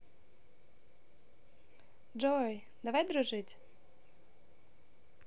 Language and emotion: Russian, positive